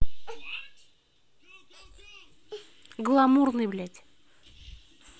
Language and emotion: Russian, angry